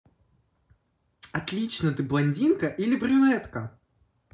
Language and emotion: Russian, positive